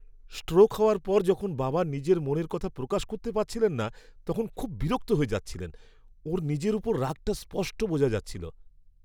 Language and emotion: Bengali, angry